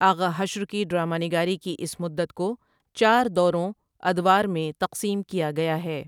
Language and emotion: Urdu, neutral